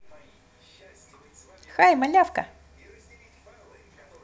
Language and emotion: Russian, positive